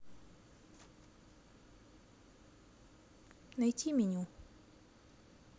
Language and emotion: Russian, neutral